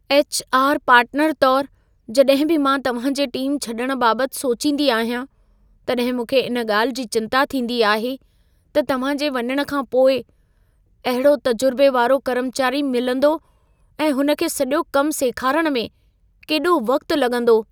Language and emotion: Sindhi, fearful